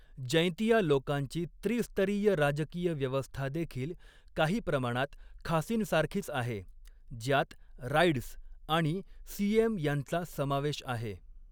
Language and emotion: Marathi, neutral